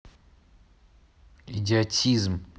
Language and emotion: Russian, angry